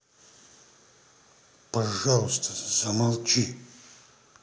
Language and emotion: Russian, angry